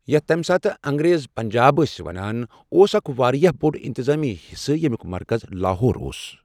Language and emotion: Kashmiri, neutral